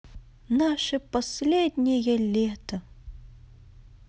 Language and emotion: Russian, positive